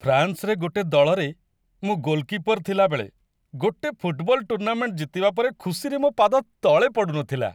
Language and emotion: Odia, happy